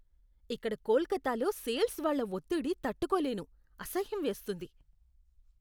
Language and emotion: Telugu, disgusted